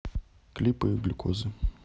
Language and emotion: Russian, neutral